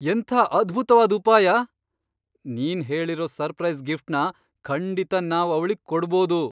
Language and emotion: Kannada, surprised